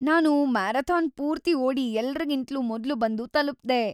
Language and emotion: Kannada, happy